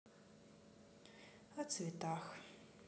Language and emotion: Russian, sad